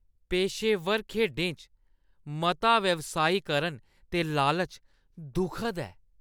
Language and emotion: Dogri, disgusted